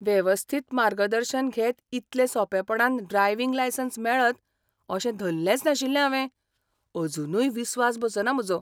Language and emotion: Goan Konkani, surprised